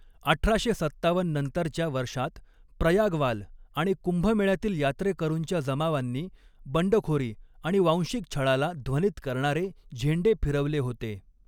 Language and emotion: Marathi, neutral